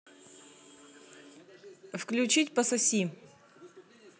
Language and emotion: Russian, neutral